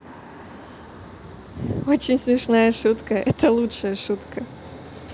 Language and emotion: Russian, positive